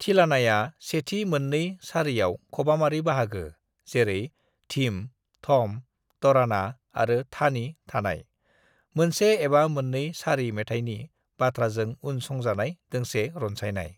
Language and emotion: Bodo, neutral